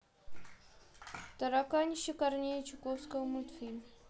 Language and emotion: Russian, neutral